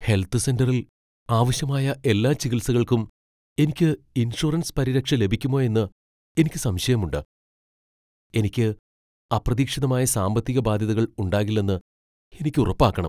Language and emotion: Malayalam, fearful